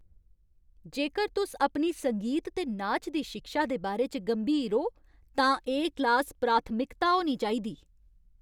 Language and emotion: Dogri, angry